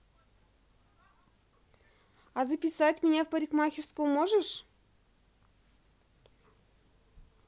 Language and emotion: Russian, positive